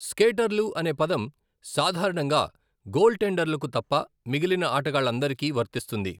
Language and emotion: Telugu, neutral